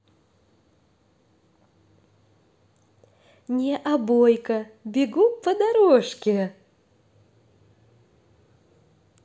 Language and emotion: Russian, positive